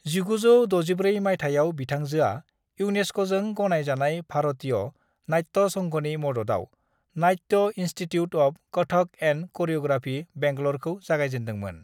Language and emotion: Bodo, neutral